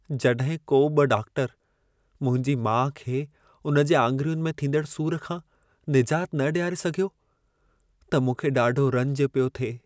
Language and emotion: Sindhi, sad